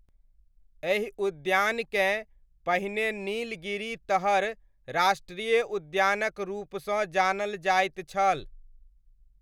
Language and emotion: Maithili, neutral